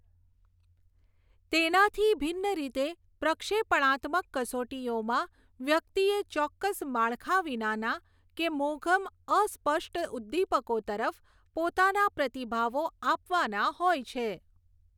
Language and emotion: Gujarati, neutral